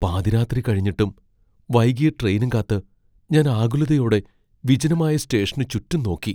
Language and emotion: Malayalam, fearful